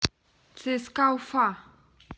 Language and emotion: Russian, neutral